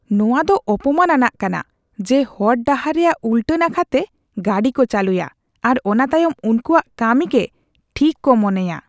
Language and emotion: Santali, disgusted